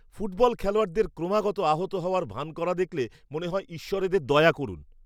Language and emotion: Bengali, disgusted